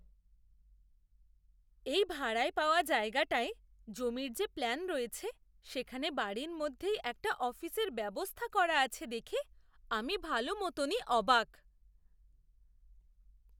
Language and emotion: Bengali, surprised